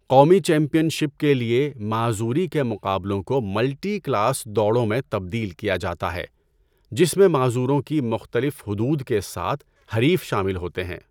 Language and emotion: Urdu, neutral